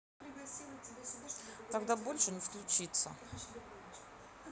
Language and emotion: Russian, neutral